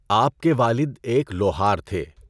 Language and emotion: Urdu, neutral